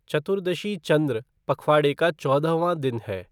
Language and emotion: Hindi, neutral